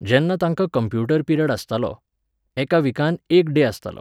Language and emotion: Goan Konkani, neutral